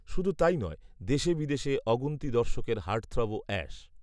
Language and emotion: Bengali, neutral